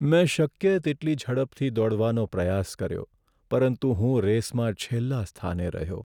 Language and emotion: Gujarati, sad